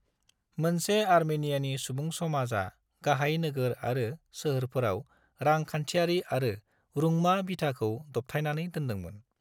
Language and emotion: Bodo, neutral